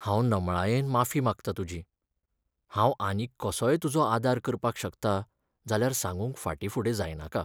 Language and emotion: Goan Konkani, sad